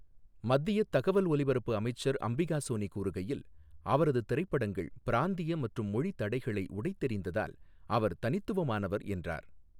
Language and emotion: Tamil, neutral